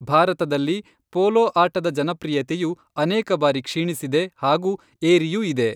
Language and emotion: Kannada, neutral